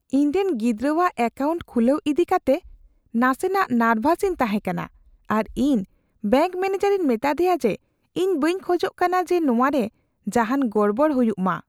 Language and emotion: Santali, fearful